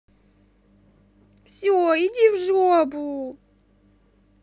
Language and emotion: Russian, sad